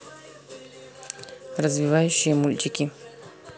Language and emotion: Russian, neutral